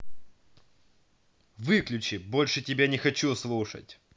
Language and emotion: Russian, angry